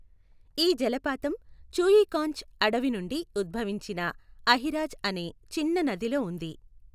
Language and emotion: Telugu, neutral